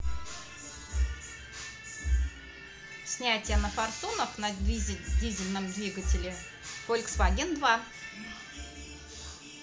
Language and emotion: Russian, neutral